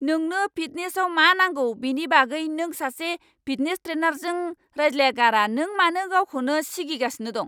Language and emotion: Bodo, angry